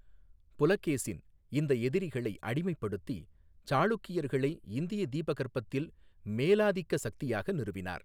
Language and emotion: Tamil, neutral